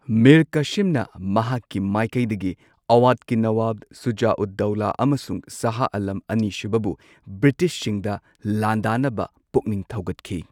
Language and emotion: Manipuri, neutral